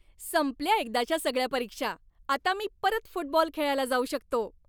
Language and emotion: Marathi, happy